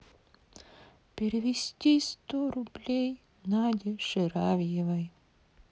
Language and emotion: Russian, sad